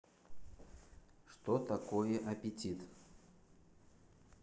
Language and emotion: Russian, neutral